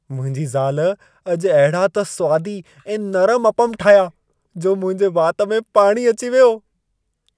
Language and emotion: Sindhi, happy